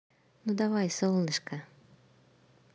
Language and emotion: Russian, positive